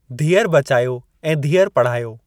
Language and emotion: Sindhi, neutral